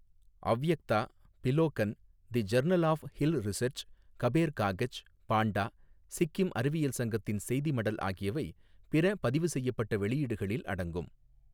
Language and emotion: Tamil, neutral